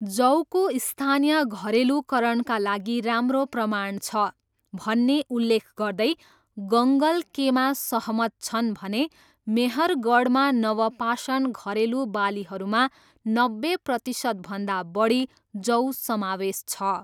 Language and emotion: Nepali, neutral